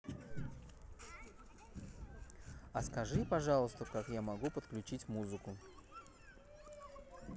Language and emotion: Russian, neutral